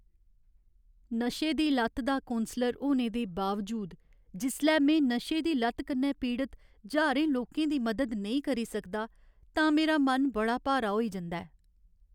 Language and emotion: Dogri, sad